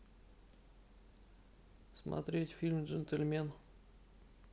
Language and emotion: Russian, neutral